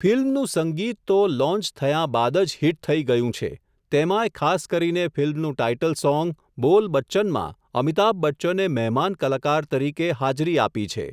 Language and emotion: Gujarati, neutral